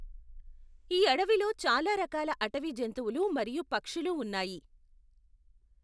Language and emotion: Telugu, neutral